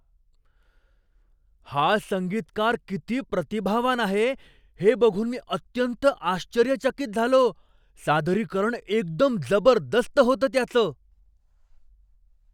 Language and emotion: Marathi, surprised